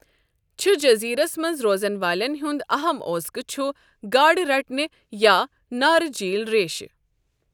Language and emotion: Kashmiri, neutral